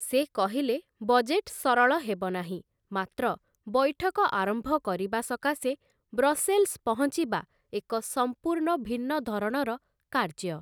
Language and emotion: Odia, neutral